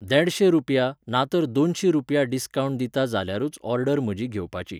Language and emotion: Goan Konkani, neutral